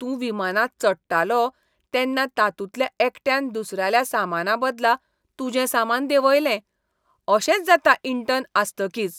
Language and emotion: Goan Konkani, disgusted